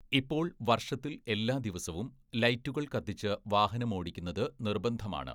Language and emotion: Malayalam, neutral